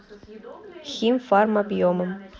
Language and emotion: Russian, neutral